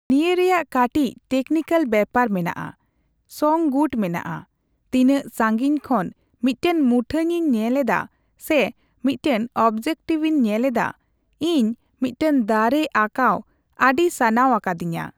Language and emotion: Santali, neutral